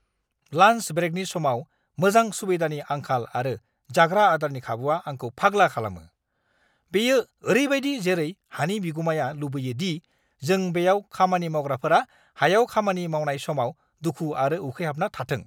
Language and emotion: Bodo, angry